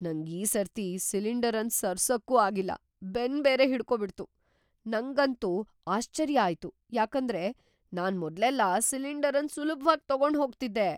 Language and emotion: Kannada, surprised